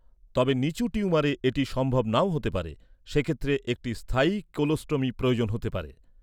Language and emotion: Bengali, neutral